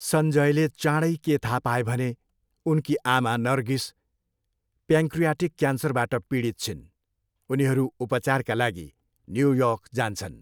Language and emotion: Nepali, neutral